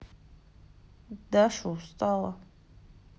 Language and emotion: Russian, sad